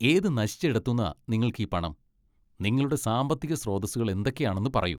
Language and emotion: Malayalam, disgusted